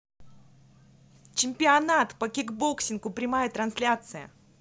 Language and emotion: Russian, positive